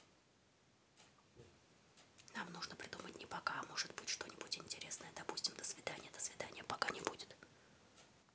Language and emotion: Russian, neutral